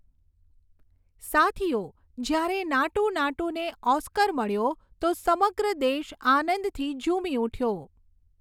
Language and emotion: Gujarati, neutral